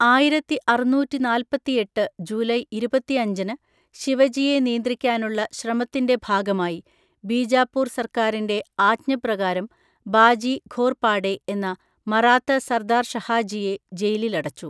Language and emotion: Malayalam, neutral